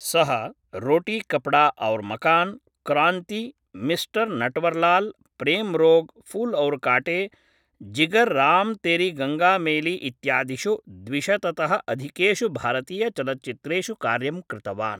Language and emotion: Sanskrit, neutral